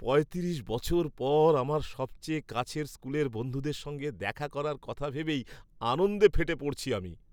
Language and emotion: Bengali, happy